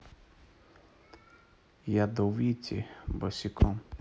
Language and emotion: Russian, neutral